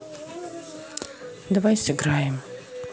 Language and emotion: Russian, neutral